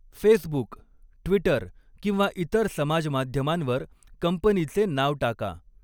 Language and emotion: Marathi, neutral